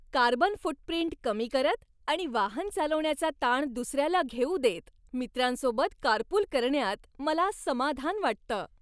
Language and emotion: Marathi, happy